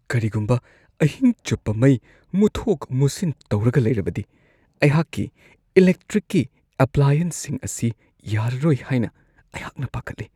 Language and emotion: Manipuri, fearful